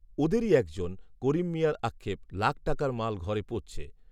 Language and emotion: Bengali, neutral